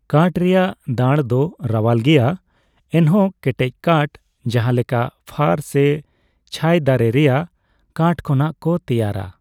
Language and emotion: Santali, neutral